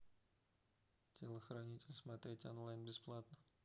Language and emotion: Russian, neutral